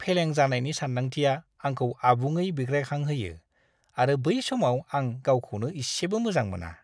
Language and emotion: Bodo, disgusted